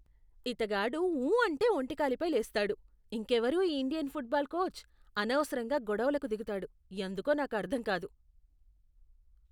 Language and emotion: Telugu, disgusted